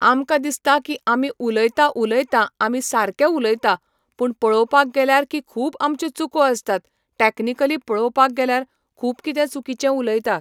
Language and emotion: Goan Konkani, neutral